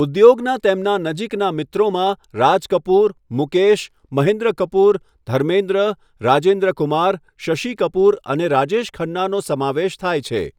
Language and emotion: Gujarati, neutral